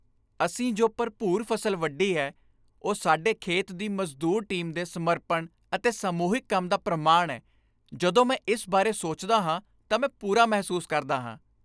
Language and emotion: Punjabi, happy